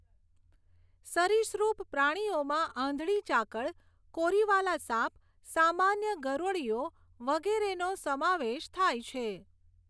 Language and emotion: Gujarati, neutral